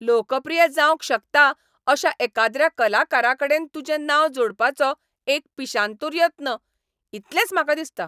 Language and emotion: Goan Konkani, angry